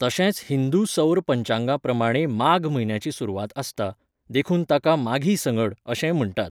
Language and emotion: Goan Konkani, neutral